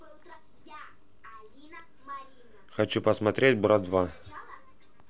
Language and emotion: Russian, neutral